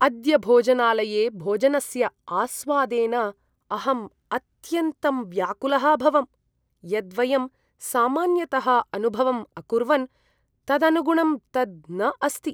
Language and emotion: Sanskrit, disgusted